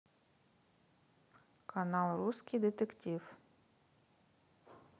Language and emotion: Russian, neutral